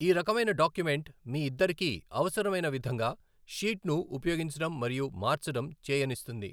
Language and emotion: Telugu, neutral